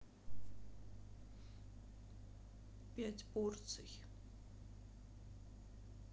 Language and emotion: Russian, sad